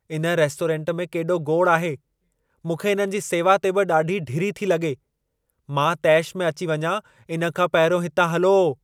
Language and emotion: Sindhi, angry